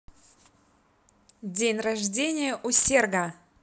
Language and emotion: Russian, positive